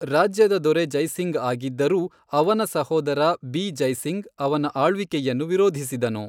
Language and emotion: Kannada, neutral